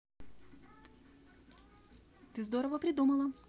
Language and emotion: Russian, positive